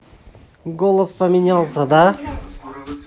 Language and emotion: Russian, positive